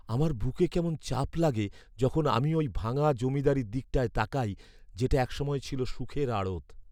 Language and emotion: Bengali, sad